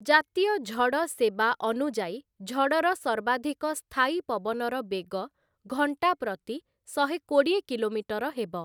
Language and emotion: Odia, neutral